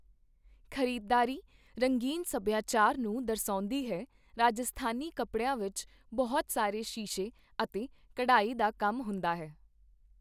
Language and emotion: Punjabi, neutral